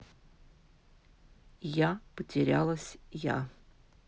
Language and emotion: Russian, neutral